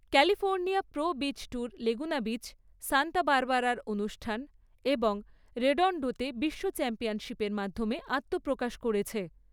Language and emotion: Bengali, neutral